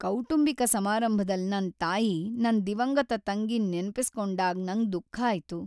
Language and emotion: Kannada, sad